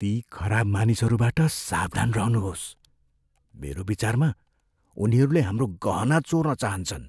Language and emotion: Nepali, fearful